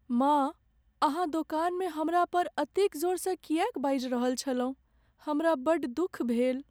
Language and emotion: Maithili, sad